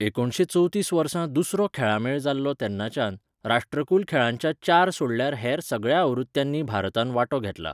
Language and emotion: Goan Konkani, neutral